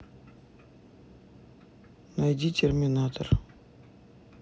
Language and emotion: Russian, neutral